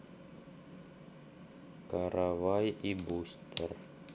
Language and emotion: Russian, neutral